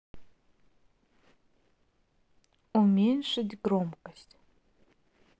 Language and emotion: Russian, neutral